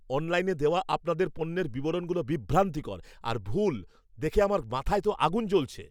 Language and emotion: Bengali, angry